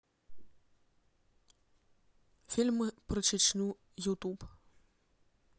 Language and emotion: Russian, neutral